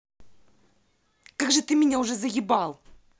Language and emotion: Russian, angry